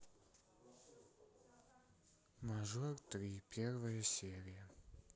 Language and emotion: Russian, sad